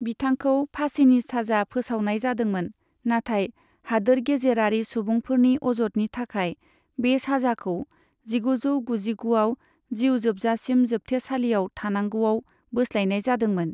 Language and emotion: Bodo, neutral